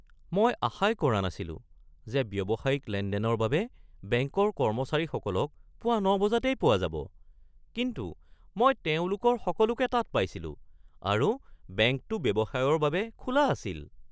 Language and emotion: Assamese, surprised